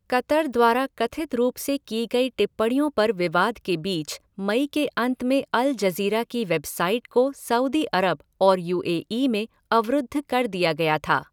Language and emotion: Hindi, neutral